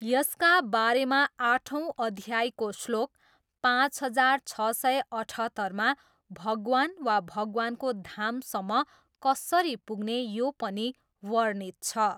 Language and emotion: Nepali, neutral